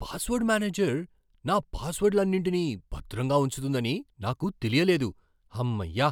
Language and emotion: Telugu, surprised